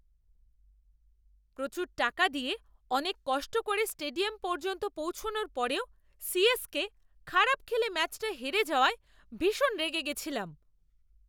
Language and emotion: Bengali, angry